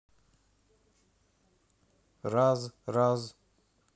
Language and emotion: Russian, neutral